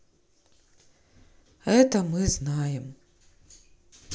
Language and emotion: Russian, sad